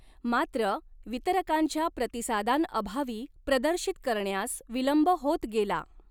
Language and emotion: Marathi, neutral